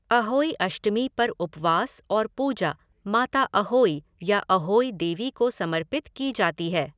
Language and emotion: Hindi, neutral